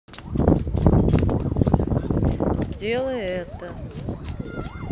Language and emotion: Russian, neutral